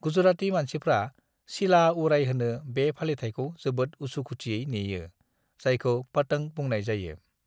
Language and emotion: Bodo, neutral